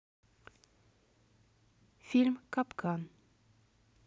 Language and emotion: Russian, neutral